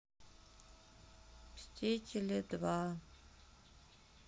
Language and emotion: Russian, sad